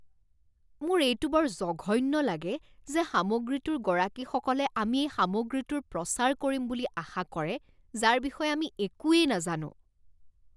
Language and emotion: Assamese, disgusted